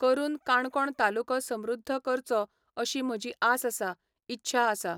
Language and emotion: Goan Konkani, neutral